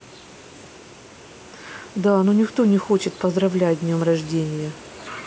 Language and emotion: Russian, sad